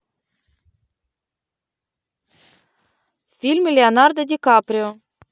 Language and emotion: Russian, neutral